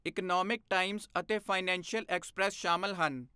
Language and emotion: Punjabi, neutral